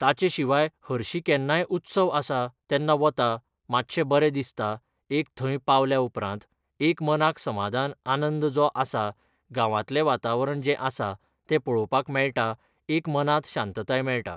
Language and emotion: Goan Konkani, neutral